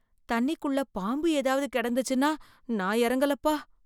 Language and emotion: Tamil, fearful